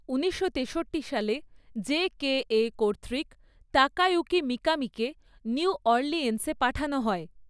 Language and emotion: Bengali, neutral